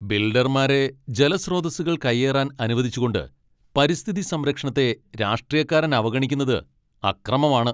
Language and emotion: Malayalam, angry